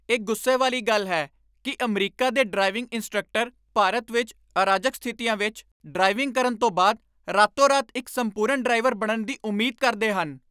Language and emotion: Punjabi, angry